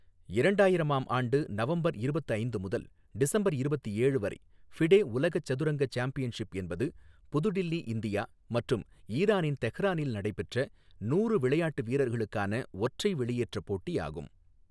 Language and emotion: Tamil, neutral